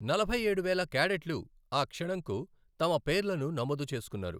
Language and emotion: Telugu, neutral